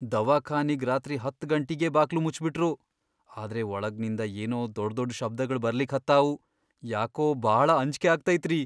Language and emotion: Kannada, fearful